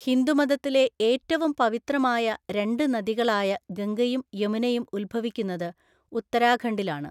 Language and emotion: Malayalam, neutral